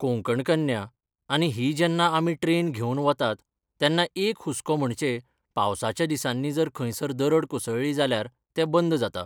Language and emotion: Goan Konkani, neutral